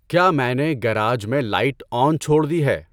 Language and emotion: Urdu, neutral